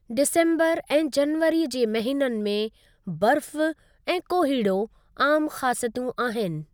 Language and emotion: Sindhi, neutral